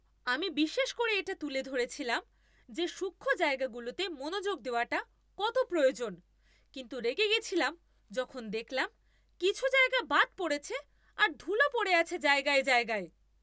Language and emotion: Bengali, angry